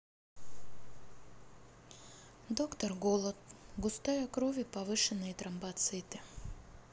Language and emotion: Russian, sad